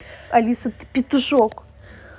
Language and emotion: Russian, angry